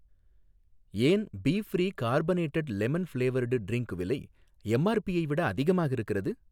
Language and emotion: Tamil, neutral